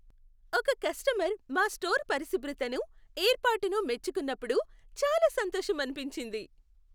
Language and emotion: Telugu, happy